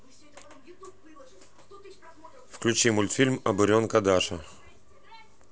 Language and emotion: Russian, neutral